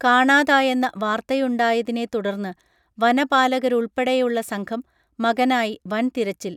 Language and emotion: Malayalam, neutral